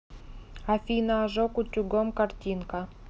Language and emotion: Russian, neutral